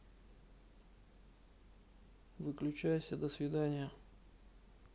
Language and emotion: Russian, neutral